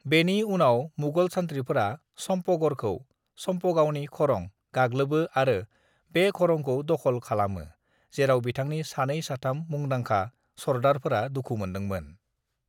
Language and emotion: Bodo, neutral